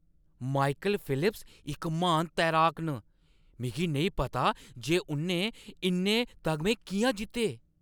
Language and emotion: Dogri, surprised